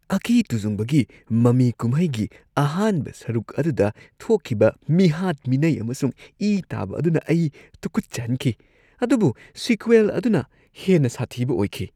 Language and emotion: Manipuri, disgusted